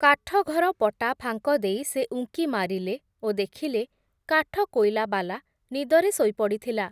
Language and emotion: Odia, neutral